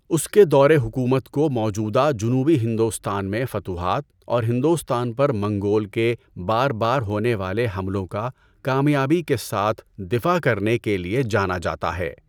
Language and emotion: Urdu, neutral